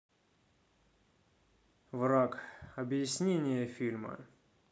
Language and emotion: Russian, neutral